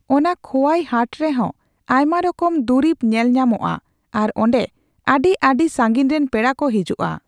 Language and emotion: Santali, neutral